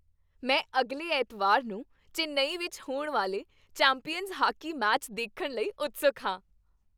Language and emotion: Punjabi, happy